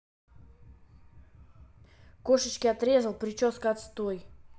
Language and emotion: Russian, angry